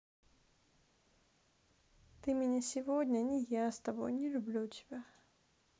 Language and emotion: Russian, sad